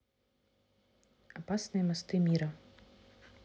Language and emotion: Russian, neutral